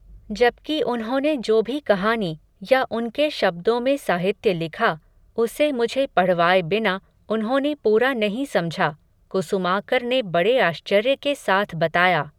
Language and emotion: Hindi, neutral